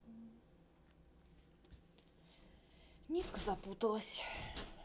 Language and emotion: Russian, neutral